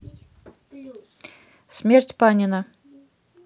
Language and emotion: Russian, neutral